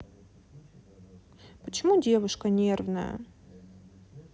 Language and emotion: Russian, sad